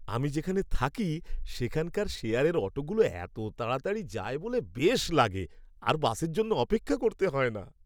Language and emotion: Bengali, happy